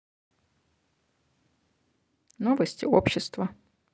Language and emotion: Russian, neutral